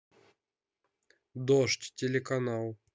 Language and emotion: Russian, neutral